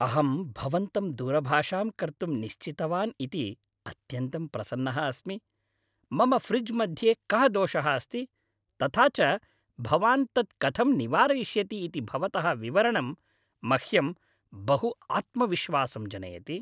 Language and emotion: Sanskrit, happy